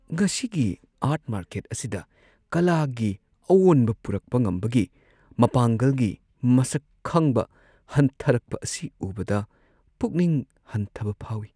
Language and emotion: Manipuri, sad